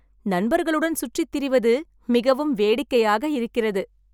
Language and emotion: Tamil, happy